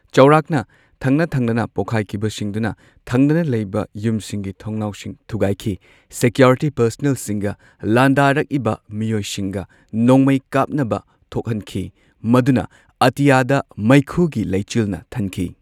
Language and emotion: Manipuri, neutral